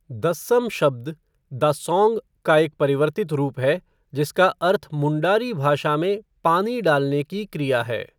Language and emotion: Hindi, neutral